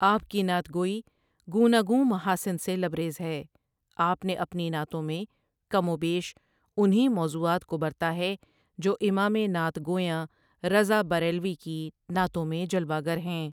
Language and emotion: Urdu, neutral